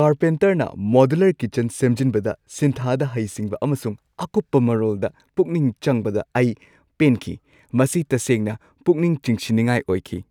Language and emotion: Manipuri, happy